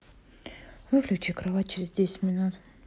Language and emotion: Russian, neutral